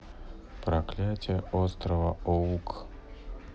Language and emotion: Russian, neutral